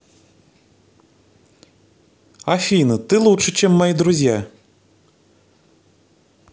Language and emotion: Russian, positive